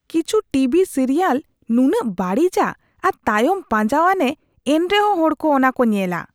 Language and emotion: Santali, disgusted